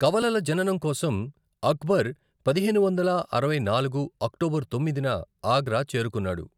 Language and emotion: Telugu, neutral